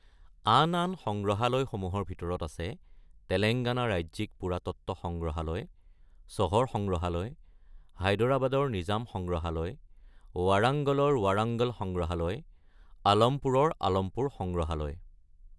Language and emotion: Assamese, neutral